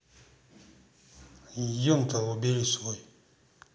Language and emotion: Russian, neutral